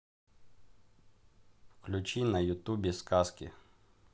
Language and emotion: Russian, neutral